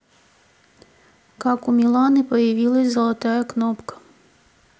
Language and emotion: Russian, neutral